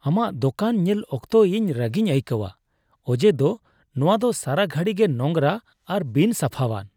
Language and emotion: Santali, disgusted